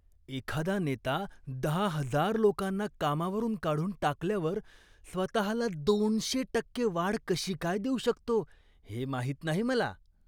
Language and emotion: Marathi, disgusted